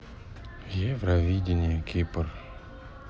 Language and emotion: Russian, sad